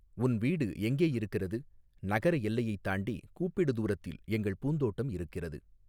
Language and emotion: Tamil, neutral